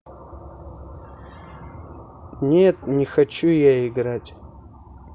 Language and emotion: Russian, neutral